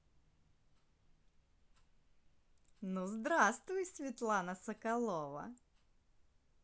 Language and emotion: Russian, positive